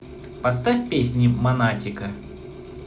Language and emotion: Russian, positive